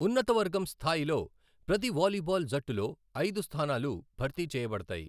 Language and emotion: Telugu, neutral